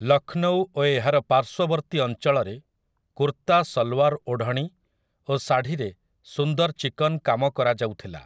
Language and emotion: Odia, neutral